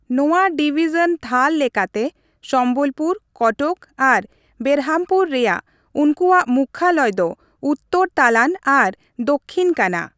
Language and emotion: Santali, neutral